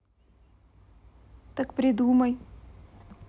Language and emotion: Russian, neutral